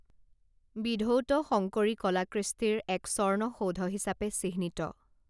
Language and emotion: Assamese, neutral